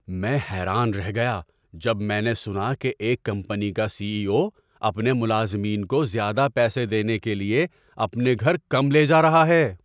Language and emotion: Urdu, surprised